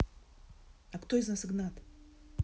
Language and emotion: Russian, neutral